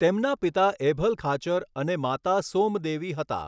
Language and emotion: Gujarati, neutral